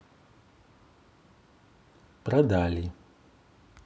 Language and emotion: Russian, neutral